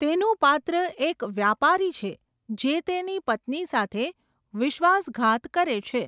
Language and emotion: Gujarati, neutral